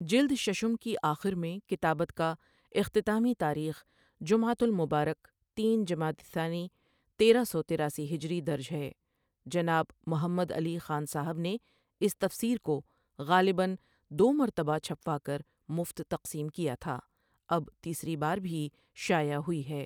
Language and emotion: Urdu, neutral